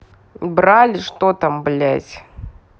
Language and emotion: Russian, angry